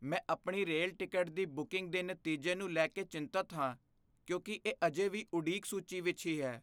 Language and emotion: Punjabi, fearful